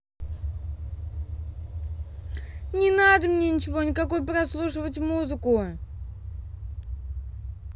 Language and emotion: Russian, angry